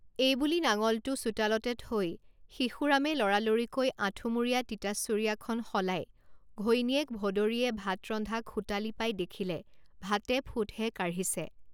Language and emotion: Assamese, neutral